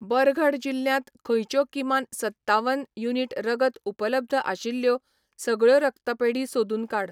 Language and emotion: Goan Konkani, neutral